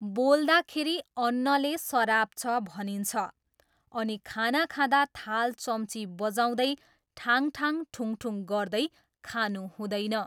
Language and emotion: Nepali, neutral